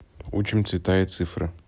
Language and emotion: Russian, neutral